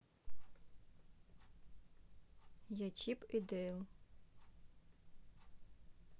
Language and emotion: Russian, neutral